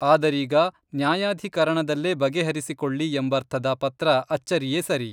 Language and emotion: Kannada, neutral